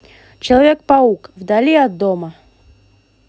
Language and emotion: Russian, positive